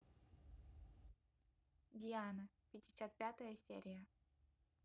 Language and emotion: Russian, neutral